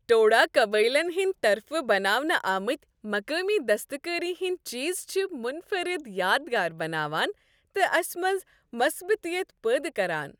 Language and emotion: Kashmiri, happy